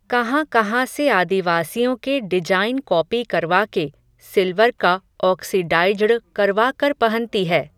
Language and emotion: Hindi, neutral